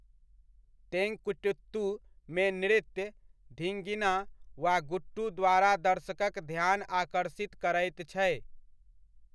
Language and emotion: Maithili, neutral